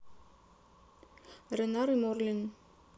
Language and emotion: Russian, neutral